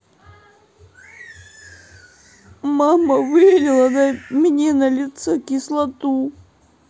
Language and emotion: Russian, sad